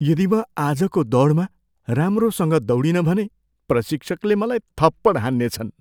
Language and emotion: Nepali, fearful